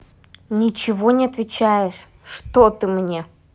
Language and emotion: Russian, angry